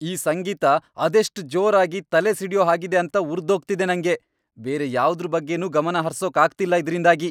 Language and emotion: Kannada, angry